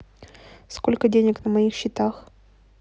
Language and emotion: Russian, neutral